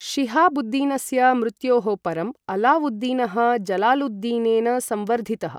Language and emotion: Sanskrit, neutral